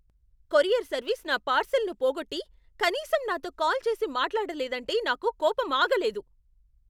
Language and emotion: Telugu, angry